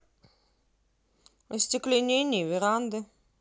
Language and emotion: Russian, neutral